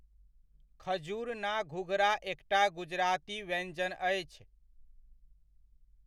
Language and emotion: Maithili, neutral